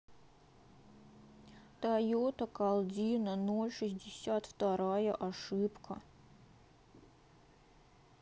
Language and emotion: Russian, sad